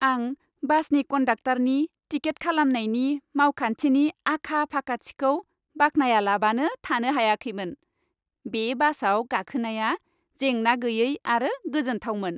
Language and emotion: Bodo, happy